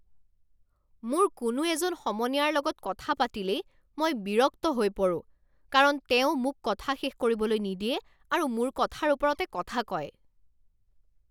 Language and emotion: Assamese, angry